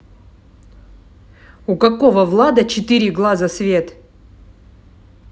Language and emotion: Russian, angry